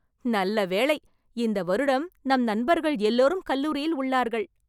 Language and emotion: Tamil, happy